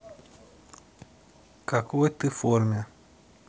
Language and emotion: Russian, neutral